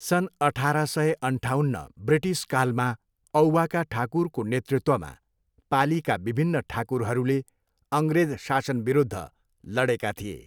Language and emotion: Nepali, neutral